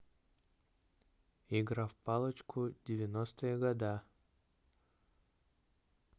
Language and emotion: Russian, neutral